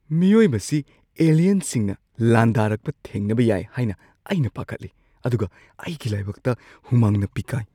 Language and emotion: Manipuri, fearful